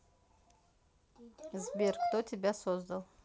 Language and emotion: Russian, neutral